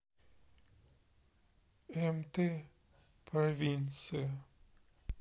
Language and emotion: Russian, sad